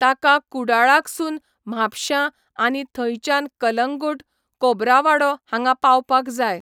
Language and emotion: Goan Konkani, neutral